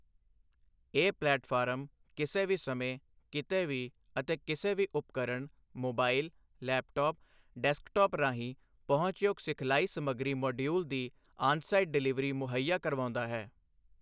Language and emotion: Punjabi, neutral